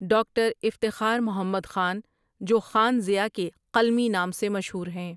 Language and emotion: Urdu, neutral